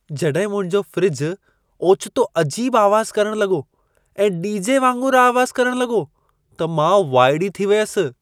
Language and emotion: Sindhi, surprised